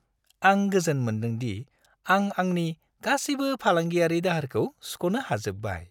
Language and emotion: Bodo, happy